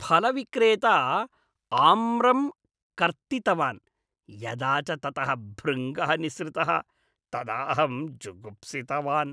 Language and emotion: Sanskrit, disgusted